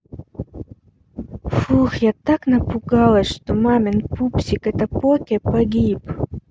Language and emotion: Russian, neutral